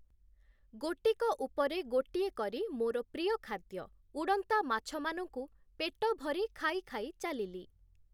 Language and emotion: Odia, neutral